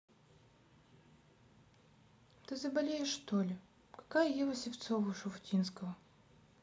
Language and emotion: Russian, sad